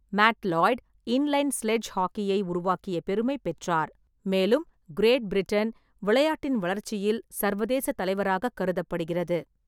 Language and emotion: Tamil, neutral